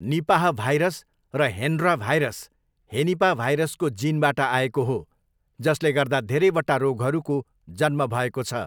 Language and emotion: Nepali, neutral